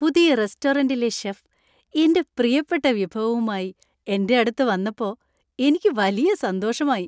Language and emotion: Malayalam, happy